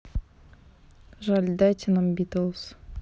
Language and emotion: Russian, neutral